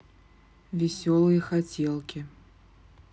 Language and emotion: Russian, neutral